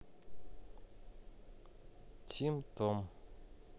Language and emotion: Russian, neutral